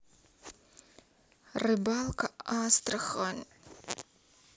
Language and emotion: Russian, sad